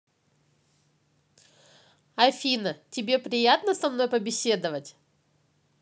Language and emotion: Russian, positive